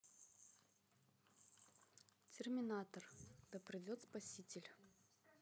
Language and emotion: Russian, neutral